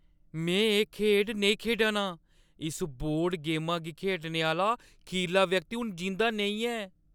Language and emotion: Dogri, fearful